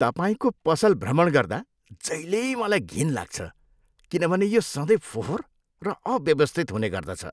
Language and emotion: Nepali, disgusted